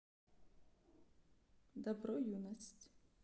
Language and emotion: Russian, sad